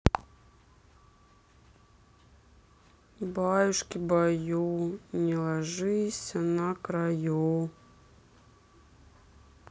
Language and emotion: Russian, sad